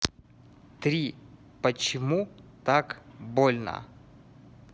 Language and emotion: Russian, neutral